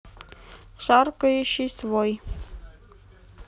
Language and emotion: Russian, neutral